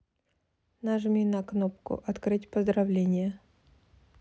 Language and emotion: Russian, neutral